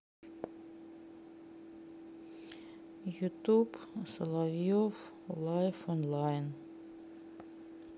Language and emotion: Russian, sad